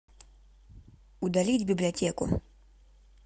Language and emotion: Russian, neutral